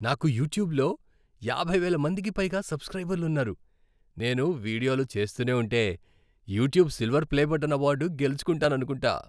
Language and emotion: Telugu, happy